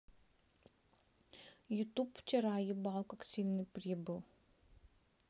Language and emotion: Russian, sad